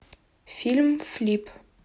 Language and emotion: Russian, neutral